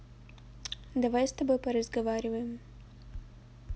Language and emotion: Russian, neutral